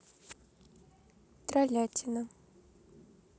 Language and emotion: Russian, neutral